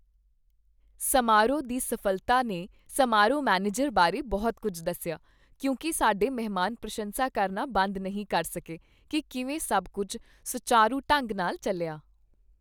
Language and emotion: Punjabi, happy